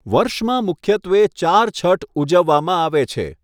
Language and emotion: Gujarati, neutral